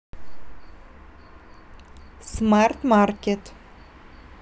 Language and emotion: Russian, neutral